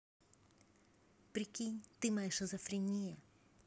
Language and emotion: Russian, positive